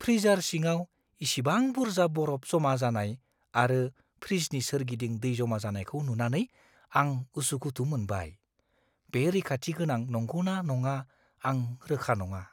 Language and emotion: Bodo, fearful